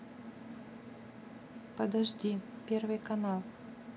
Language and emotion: Russian, neutral